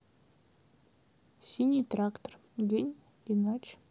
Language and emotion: Russian, neutral